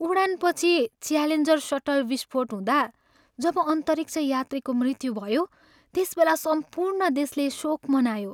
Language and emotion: Nepali, sad